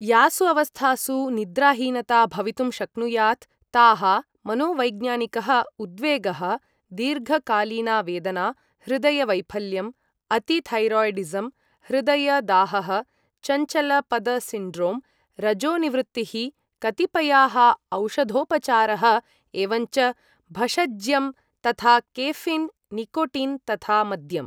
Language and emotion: Sanskrit, neutral